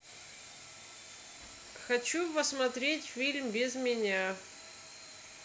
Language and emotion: Russian, neutral